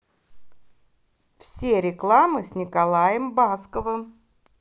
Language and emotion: Russian, positive